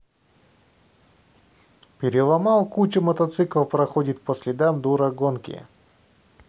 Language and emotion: Russian, neutral